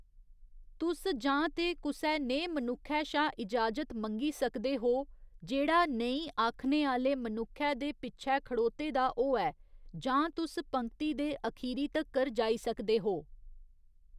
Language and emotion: Dogri, neutral